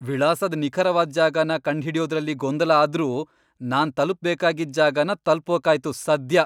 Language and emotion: Kannada, happy